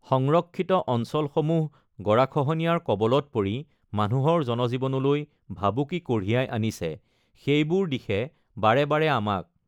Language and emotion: Assamese, neutral